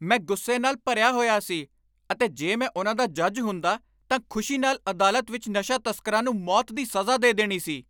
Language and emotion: Punjabi, angry